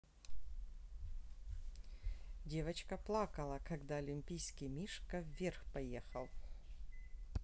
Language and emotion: Russian, neutral